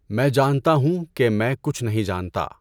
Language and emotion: Urdu, neutral